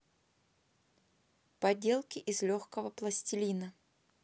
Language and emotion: Russian, neutral